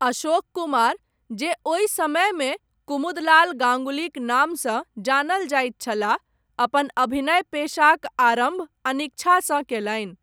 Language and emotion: Maithili, neutral